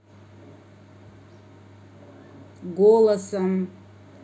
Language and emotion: Russian, angry